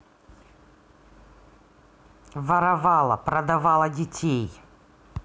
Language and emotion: Russian, angry